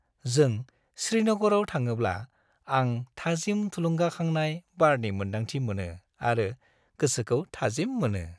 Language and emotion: Bodo, happy